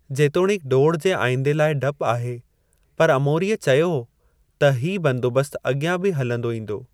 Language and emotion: Sindhi, neutral